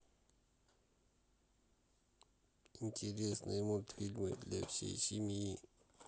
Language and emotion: Russian, sad